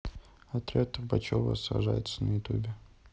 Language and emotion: Russian, neutral